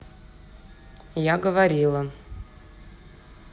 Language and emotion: Russian, neutral